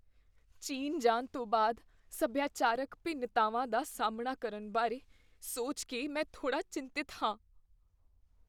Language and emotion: Punjabi, fearful